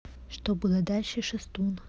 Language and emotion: Russian, neutral